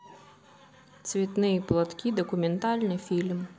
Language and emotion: Russian, neutral